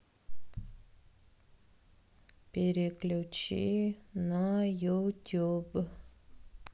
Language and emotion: Russian, sad